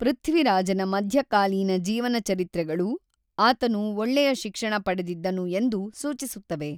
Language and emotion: Kannada, neutral